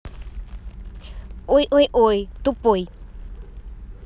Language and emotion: Russian, neutral